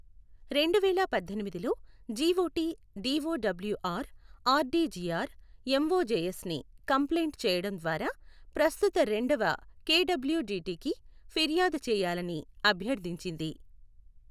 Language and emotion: Telugu, neutral